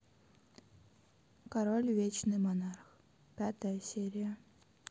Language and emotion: Russian, neutral